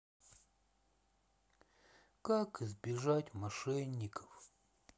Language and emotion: Russian, sad